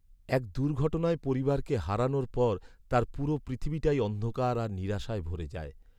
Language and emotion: Bengali, sad